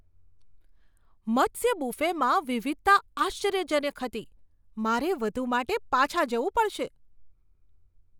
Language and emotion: Gujarati, surprised